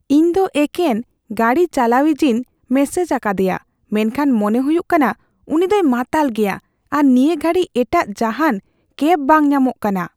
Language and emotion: Santali, fearful